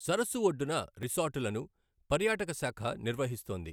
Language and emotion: Telugu, neutral